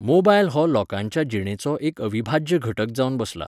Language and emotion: Goan Konkani, neutral